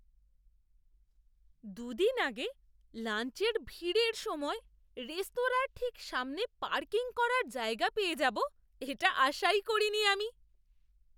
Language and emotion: Bengali, surprised